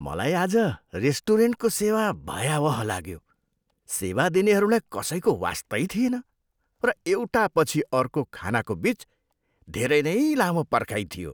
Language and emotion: Nepali, disgusted